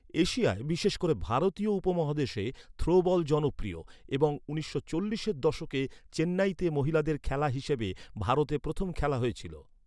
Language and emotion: Bengali, neutral